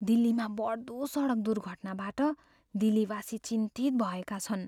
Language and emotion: Nepali, fearful